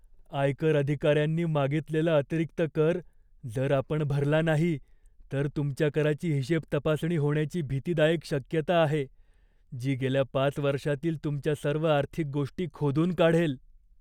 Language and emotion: Marathi, fearful